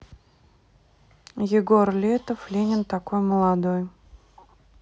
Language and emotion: Russian, neutral